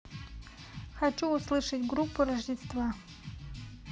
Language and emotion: Russian, neutral